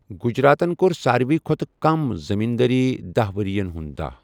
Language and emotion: Kashmiri, neutral